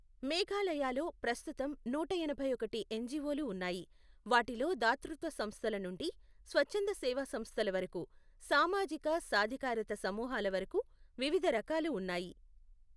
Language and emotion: Telugu, neutral